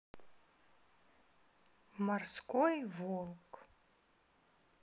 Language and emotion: Russian, sad